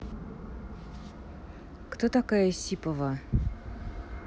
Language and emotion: Russian, neutral